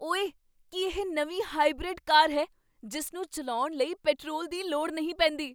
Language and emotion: Punjabi, surprised